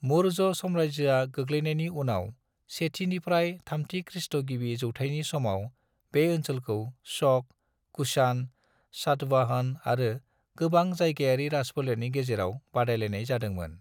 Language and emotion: Bodo, neutral